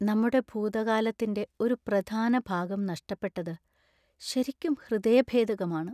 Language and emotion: Malayalam, sad